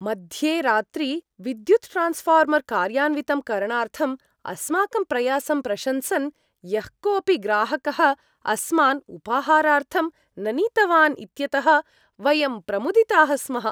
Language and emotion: Sanskrit, happy